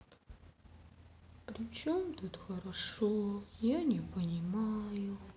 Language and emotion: Russian, sad